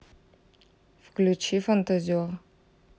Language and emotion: Russian, neutral